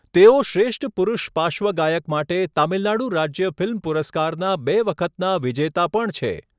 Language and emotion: Gujarati, neutral